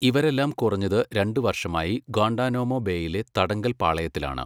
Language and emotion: Malayalam, neutral